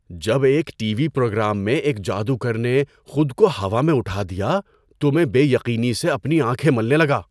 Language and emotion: Urdu, surprised